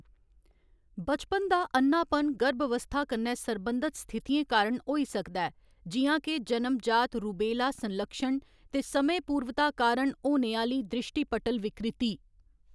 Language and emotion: Dogri, neutral